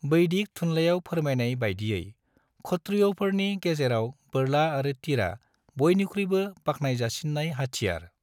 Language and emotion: Bodo, neutral